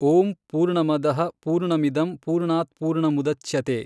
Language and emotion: Kannada, neutral